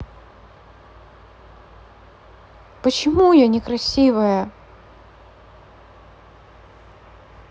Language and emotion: Russian, sad